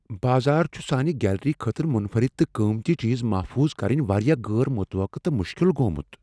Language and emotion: Kashmiri, fearful